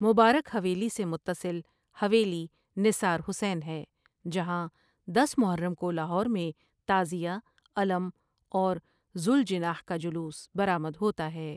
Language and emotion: Urdu, neutral